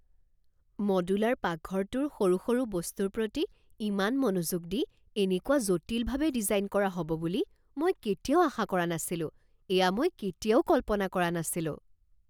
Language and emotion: Assamese, surprised